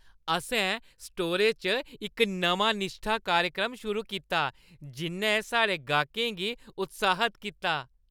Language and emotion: Dogri, happy